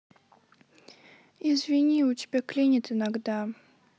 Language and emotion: Russian, sad